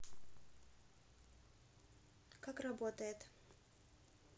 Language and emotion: Russian, neutral